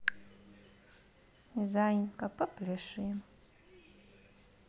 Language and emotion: Russian, neutral